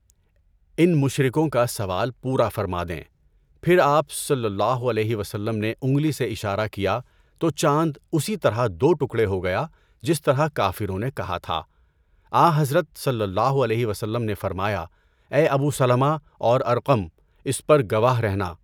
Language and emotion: Urdu, neutral